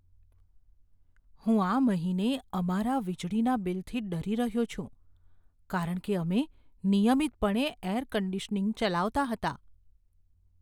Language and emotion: Gujarati, fearful